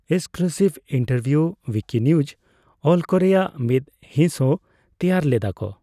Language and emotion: Santali, neutral